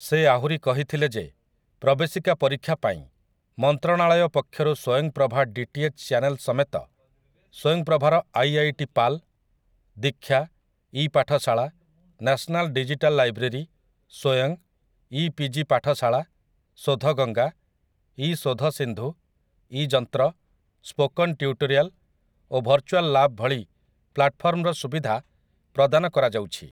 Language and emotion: Odia, neutral